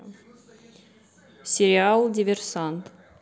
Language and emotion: Russian, neutral